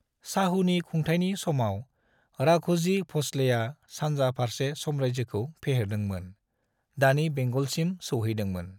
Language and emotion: Bodo, neutral